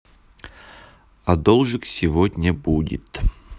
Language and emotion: Russian, neutral